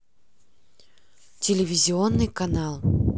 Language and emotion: Russian, neutral